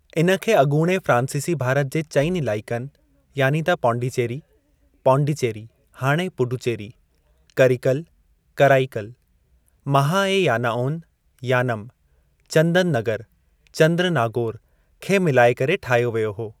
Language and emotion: Sindhi, neutral